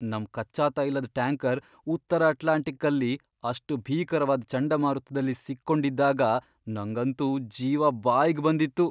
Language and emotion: Kannada, fearful